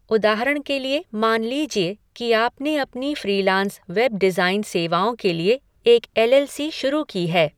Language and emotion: Hindi, neutral